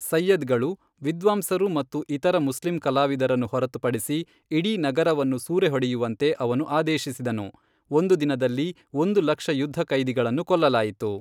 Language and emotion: Kannada, neutral